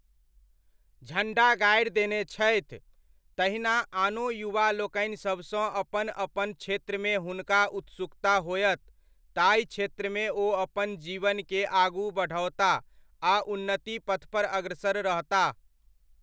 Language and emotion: Maithili, neutral